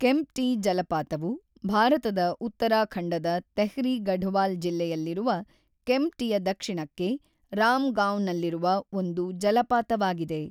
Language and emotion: Kannada, neutral